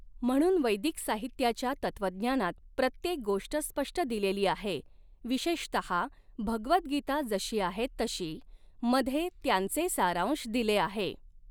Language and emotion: Marathi, neutral